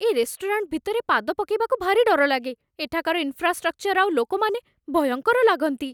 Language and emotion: Odia, fearful